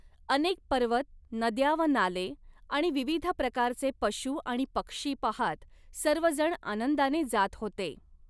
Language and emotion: Marathi, neutral